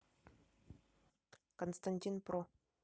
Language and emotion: Russian, neutral